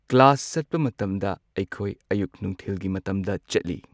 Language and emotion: Manipuri, neutral